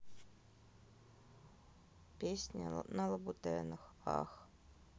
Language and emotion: Russian, neutral